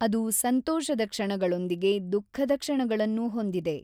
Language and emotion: Kannada, neutral